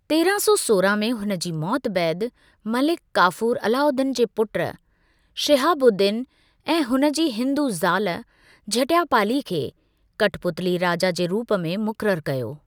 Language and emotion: Sindhi, neutral